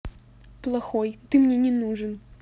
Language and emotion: Russian, angry